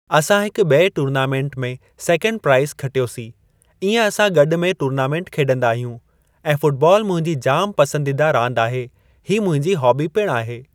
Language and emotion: Sindhi, neutral